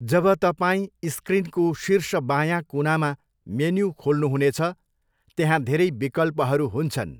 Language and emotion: Nepali, neutral